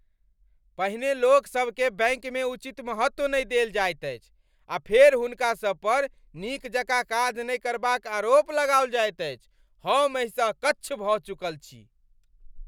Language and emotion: Maithili, angry